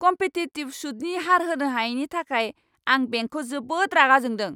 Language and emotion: Bodo, angry